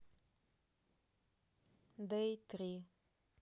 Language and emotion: Russian, neutral